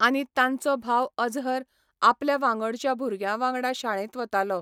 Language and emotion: Goan Konkani, neutral